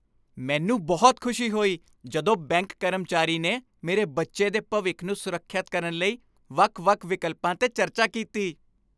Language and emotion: Punjabi, happy